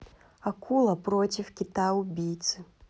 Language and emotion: Russian, neutral